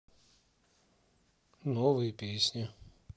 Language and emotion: Russian, neutral